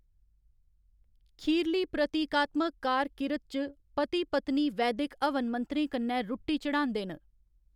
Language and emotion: Dogri, neutral